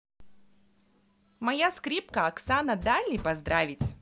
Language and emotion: Russian, positive